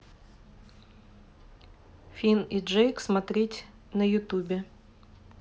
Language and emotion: Russian, neutral